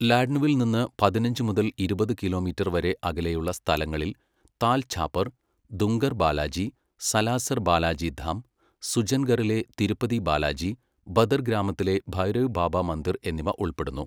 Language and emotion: Malayalam, neutral